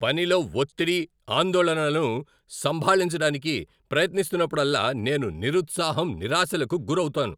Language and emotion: Telugu, angry